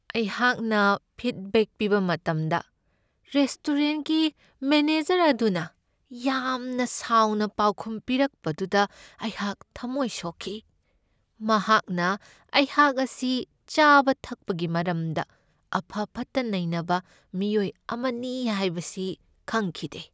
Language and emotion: Manipuri, sad